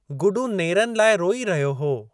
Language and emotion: Sindhi, neutral